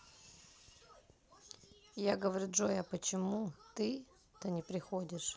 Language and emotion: Russian, neutral